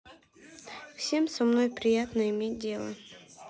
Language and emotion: Russian, neutral